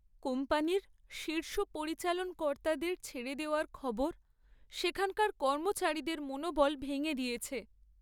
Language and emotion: Bengali, sad